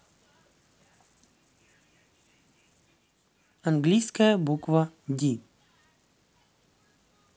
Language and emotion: Russian, neutral